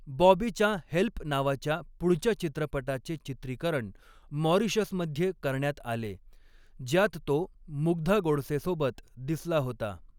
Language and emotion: Marathi, neutral